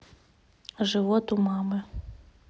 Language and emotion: Russian, neutral